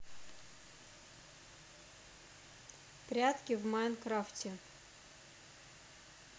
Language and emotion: Russian, neutral